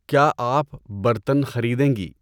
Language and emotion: Urdu, neutral